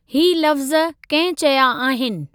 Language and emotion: Sindhi, neutral